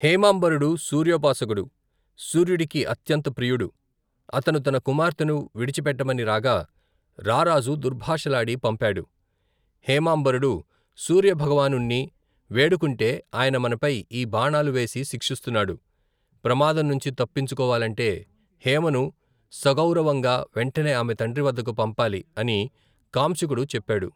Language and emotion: Telugu, neutral